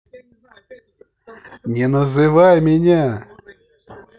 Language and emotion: Russian, angry